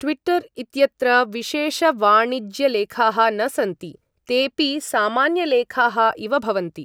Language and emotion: Sanskrit, neutral